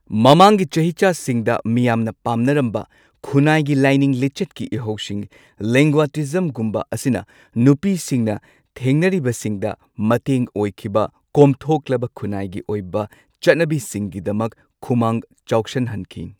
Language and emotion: Manipuri, neutral